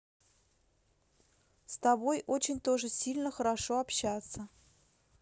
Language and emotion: Russian, neutral